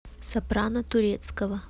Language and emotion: Russian, neutral